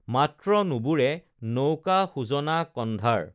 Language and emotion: Assamese, neutral